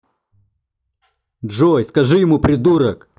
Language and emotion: Russian, angry